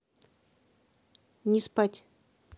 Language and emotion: Russian, neutral